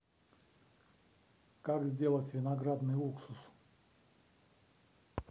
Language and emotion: Russian, neutral